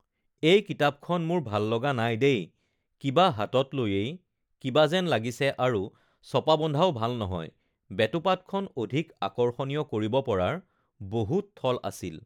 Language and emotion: Assamese, neutral